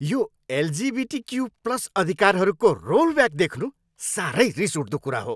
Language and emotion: Nepali, angry